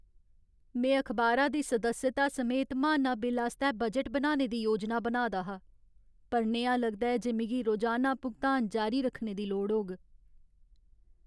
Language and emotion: Dogri, sad